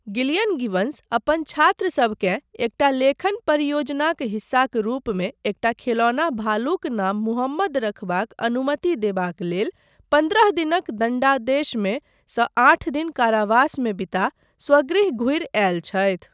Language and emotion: Maithili, neutral